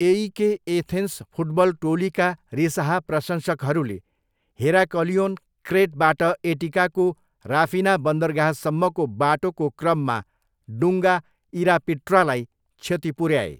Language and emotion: Nepali, neutral